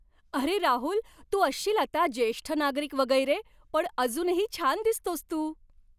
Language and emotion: Marathi, happy